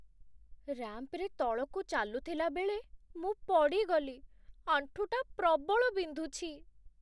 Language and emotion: Odia, sad